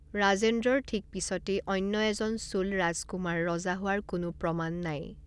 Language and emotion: Assamese, neutral